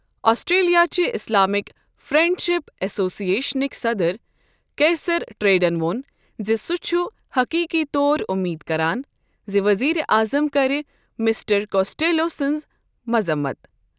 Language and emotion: Kashmiri, neutral